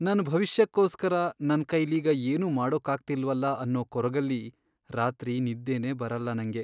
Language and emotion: Kannada, sad